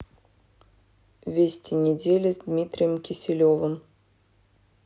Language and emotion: Russian, neutral